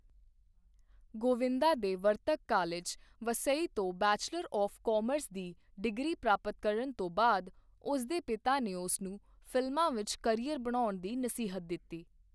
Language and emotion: Punjabi, neutral